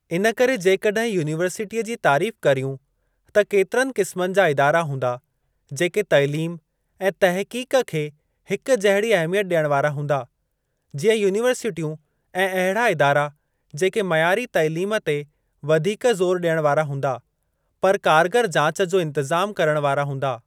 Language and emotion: Sindhi, neutral